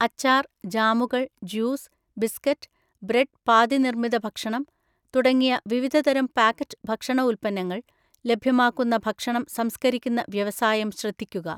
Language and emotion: Malayalam, neutral